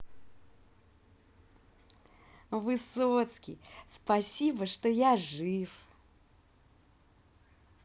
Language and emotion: Russian, positive